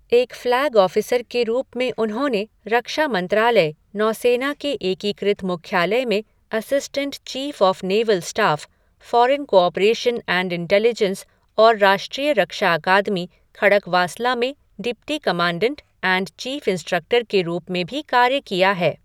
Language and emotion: Hindi, neutral